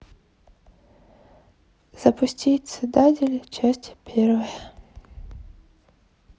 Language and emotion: Russian, sad